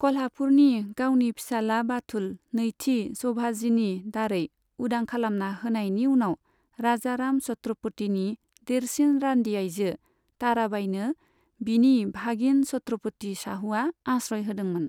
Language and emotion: Bodo, neutral